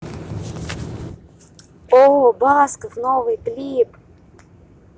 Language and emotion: Russian, positive